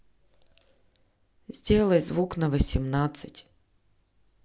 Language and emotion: Russian, neutral